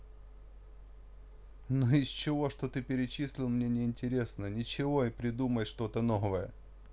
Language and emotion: Russian, neutral